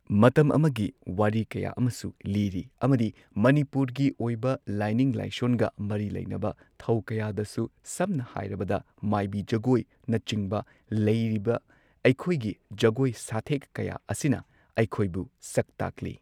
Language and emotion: Manipuri, neutral